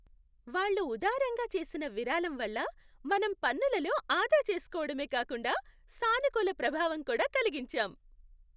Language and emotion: Telugu, happy